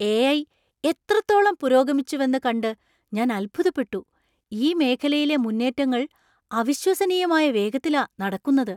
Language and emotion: Malayalam, surprised